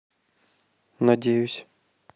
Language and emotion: Russian, neutral